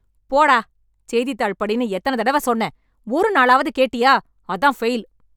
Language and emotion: Tamil, angry